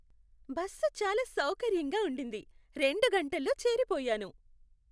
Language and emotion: Telugu, happy